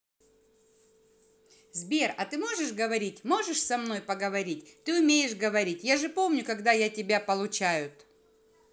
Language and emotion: Russian, positive